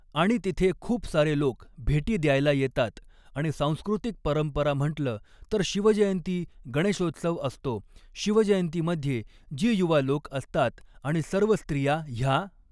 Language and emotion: Marathi, neutral